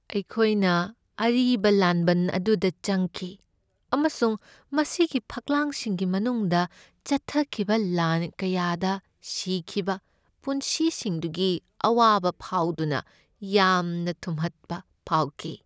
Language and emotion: Manipuri, sad